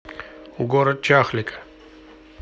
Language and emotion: Russian, neutral